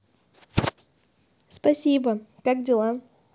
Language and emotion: Russian, positive